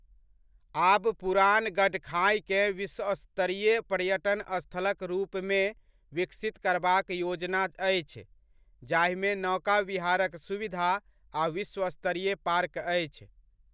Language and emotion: Maithili, neutral